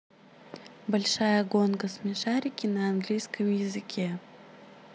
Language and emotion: Russian, positive